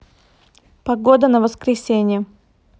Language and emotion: Russian, neutral